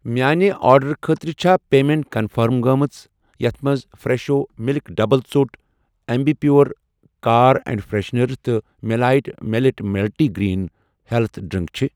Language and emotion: Kashmiri, neutral